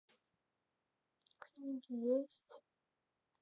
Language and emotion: Russian, sad